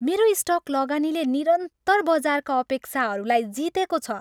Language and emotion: Nepali, happy